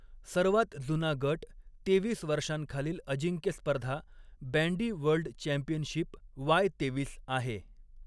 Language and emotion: Marathi, neutral